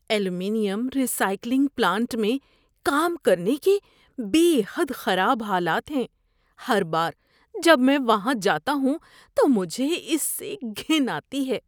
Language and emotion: Urdu, disgusted